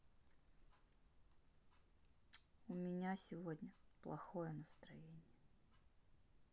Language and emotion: Russian, sad